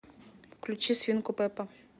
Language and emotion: Russian, neutral